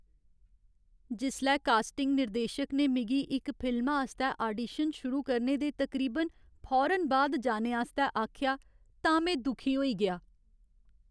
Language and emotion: Dogri, sad